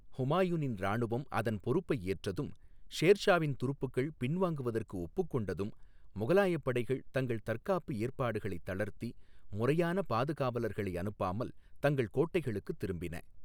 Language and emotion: Tamil, neutral